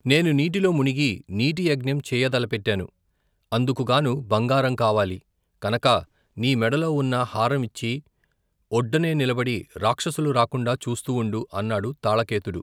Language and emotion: Telugu, neutral